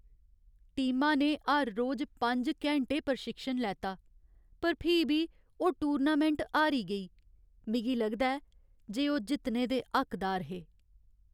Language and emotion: Dogri, sad